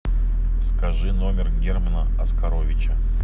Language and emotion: Russian, neutral